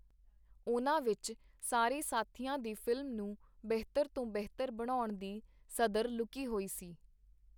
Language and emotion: Punjabi, neutral